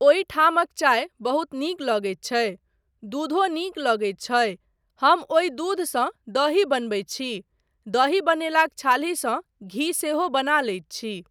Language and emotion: Maithili, neutral